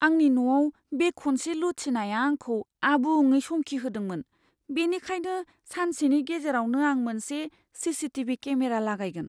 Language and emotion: Bodo, fearful